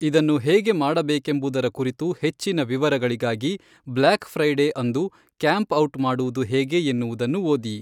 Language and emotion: Kannada, neutral